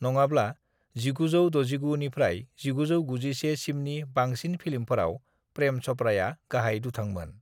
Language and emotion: Bodo, neutral